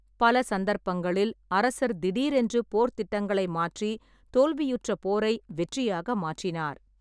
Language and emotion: Tamil, neutral